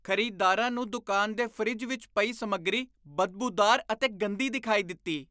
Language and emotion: Punjabi, disgusted